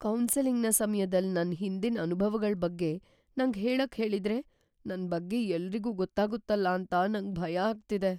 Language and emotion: Kannada, fearful